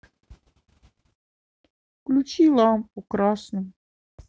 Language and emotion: Russian, sad